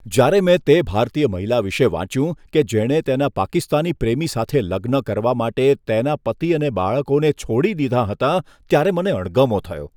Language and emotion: Gujarati, disgusted